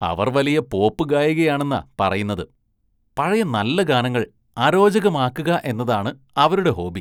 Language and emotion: Malayalam, disgusted